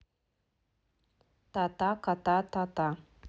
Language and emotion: Russian, neutral